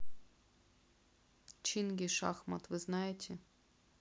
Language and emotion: Russian, neutral